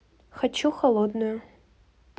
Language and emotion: Russian, neutral